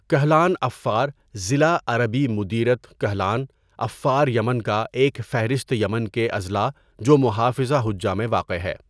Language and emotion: Urdu, neutral